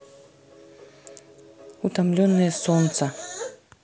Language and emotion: Russian, neutral